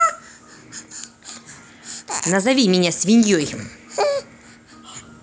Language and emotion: Russian, angry